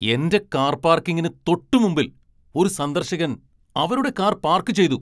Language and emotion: Malayalam, angry